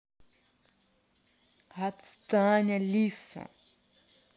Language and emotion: Russian, angry